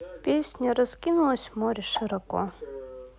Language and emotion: Russian, neutral